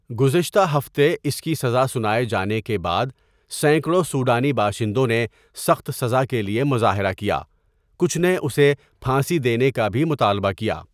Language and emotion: Urdu, neutral